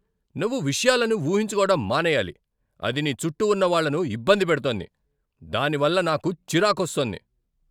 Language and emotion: Telugu, angry